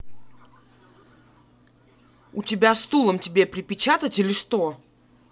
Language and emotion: Russian, angry